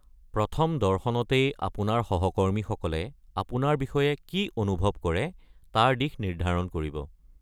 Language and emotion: Assamese, neutral